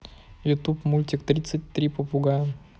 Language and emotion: Russian, neutral